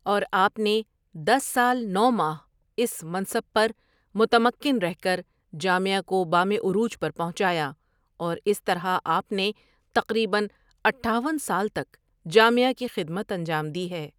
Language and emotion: Urdu, neutral